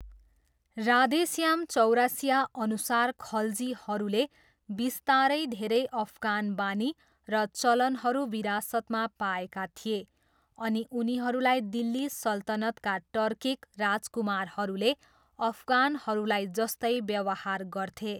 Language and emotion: Nepali, neutral